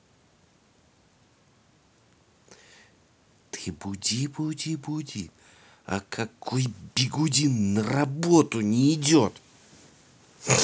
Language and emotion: Russian, angry